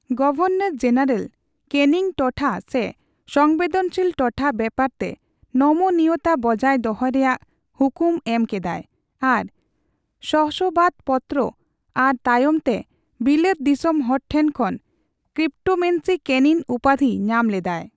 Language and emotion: Santali, neutral